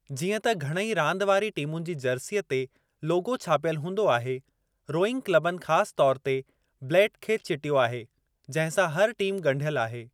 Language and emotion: Sindhi, neutral